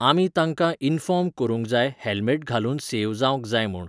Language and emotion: Goan Konkani, neutral